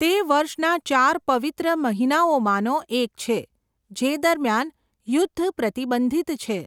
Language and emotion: Gujarati, neutral